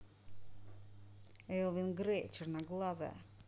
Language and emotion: Russian, neutral